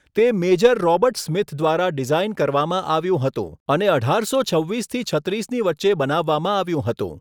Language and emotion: Gujarati, neutral